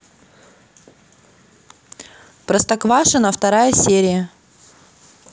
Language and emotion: Russian, neutral